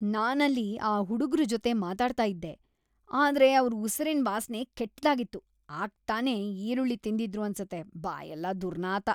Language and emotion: Kannada, disgusted